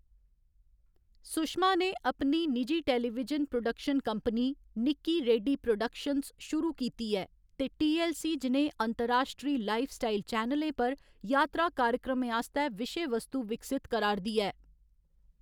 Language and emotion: Dogri, neutral